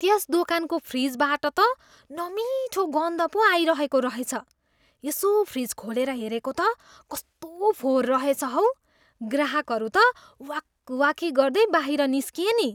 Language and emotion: Nepali, disgusted